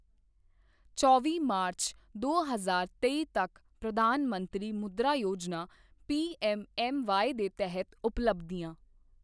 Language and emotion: Punjabi, neutral